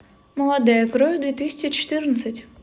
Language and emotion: Russian, positive